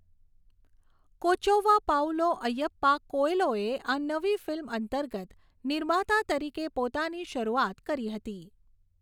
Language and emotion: Gujarati, neutral